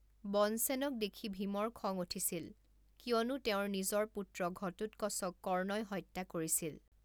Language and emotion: Assamese, neutral